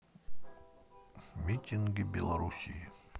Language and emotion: Russian, sad